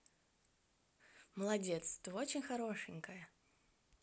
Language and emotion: Russian, positive